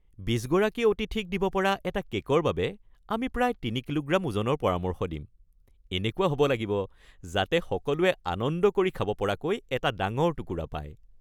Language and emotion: Assamese, happy